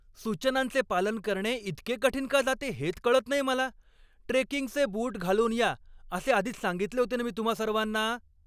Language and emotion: Marathi, angry